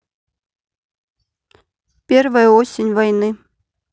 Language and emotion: Russian, neutral